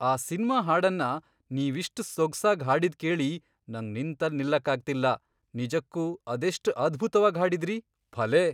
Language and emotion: Kannada, surprised